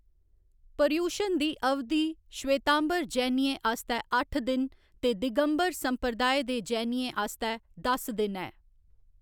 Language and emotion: Dogri, neutral